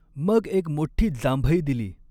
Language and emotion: Marathi, neutral